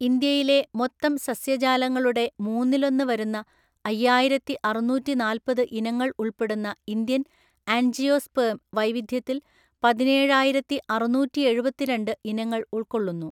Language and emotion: Malayalam, neutral